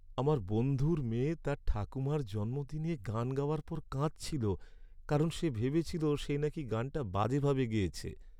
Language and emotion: Bengali, sad